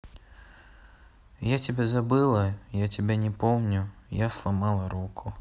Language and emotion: Russian, sad